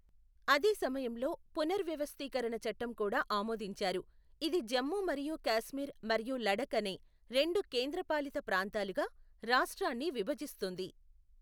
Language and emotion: Telugu, neutral